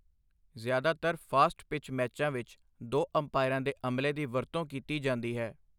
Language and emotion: Punjabi, neutral